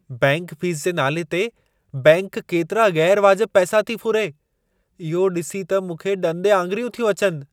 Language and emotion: Sindhi, surprised